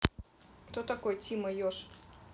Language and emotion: Russian, neutral